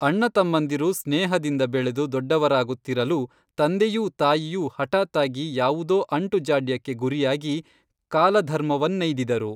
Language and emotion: Kannada, neutral